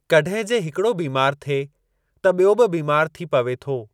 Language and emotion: Sindhi, neutral